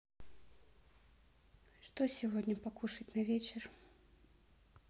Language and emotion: Russian, neutral